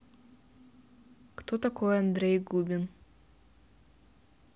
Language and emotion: Russian, neutral